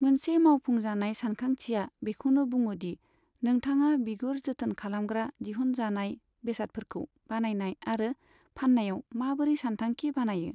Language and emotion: Bodo, neutral